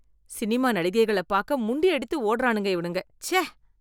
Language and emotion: Tamil, disgusted